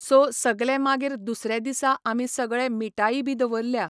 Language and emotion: Goan Konkani, neutral